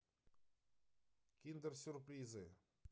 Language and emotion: Russian, neutral